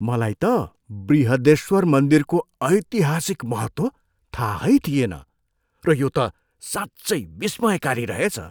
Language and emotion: Nepali, surprised